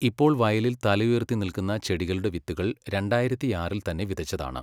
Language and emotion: Malayalam, neutral